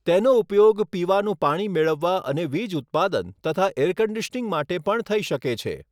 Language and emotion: Gujarati, neutral